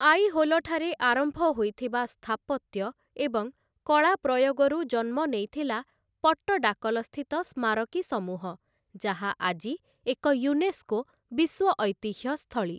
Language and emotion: Odia, neutral